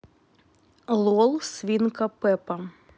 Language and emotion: Russian, neutral